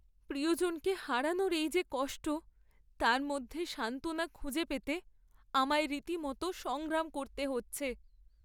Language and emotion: Bengali, sad